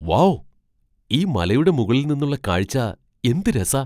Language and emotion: Malayalam, surprised